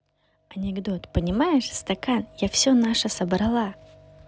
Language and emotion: Russian, positive